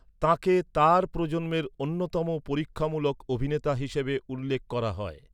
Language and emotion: Bengali, neutral